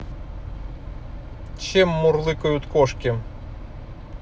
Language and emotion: Russian, neutral